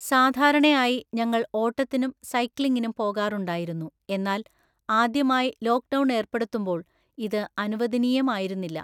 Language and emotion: Malayalam, neutral